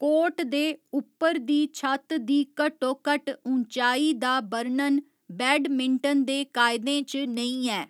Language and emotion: Dogri, neutral